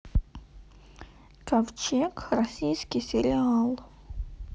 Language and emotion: Russian, neutral